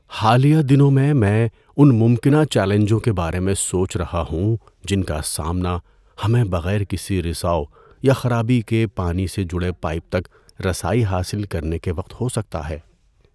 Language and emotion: Urdu, fearful